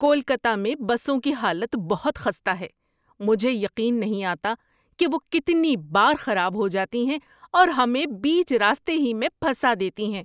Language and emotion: Urdu, disgusted